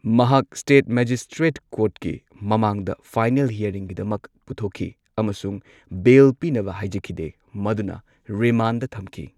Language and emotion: Manipuri, neutral